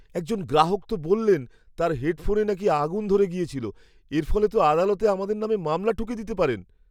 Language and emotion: Bengali, fearful